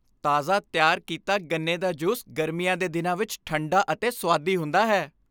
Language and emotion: Punjabi, happy